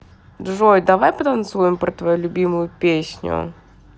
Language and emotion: Russian, positive